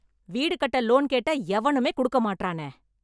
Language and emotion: Tamil, angry